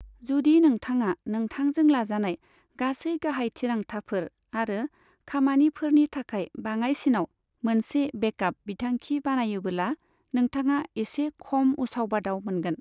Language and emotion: Bodo, neutral